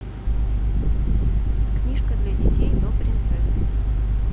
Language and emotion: Russian, neutral